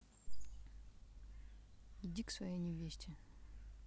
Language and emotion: Russian, angry